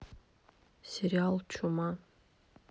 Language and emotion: Russian, neutral